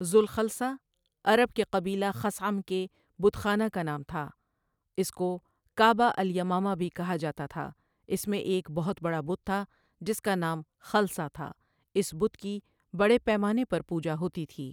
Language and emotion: Urdu, neutral